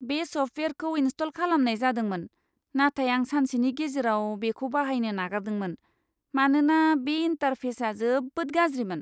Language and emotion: Bodo, disgusted